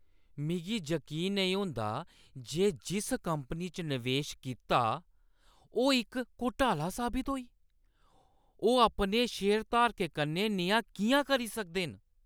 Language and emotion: Dogri, angry